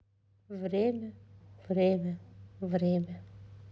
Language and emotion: Russian, sad